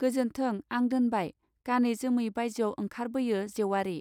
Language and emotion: Bodo, neutral